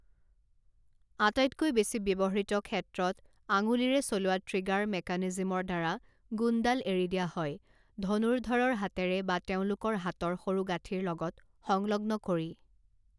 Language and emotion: Assamese, neutral